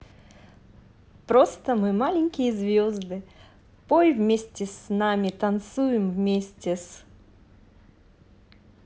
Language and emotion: Russian, positive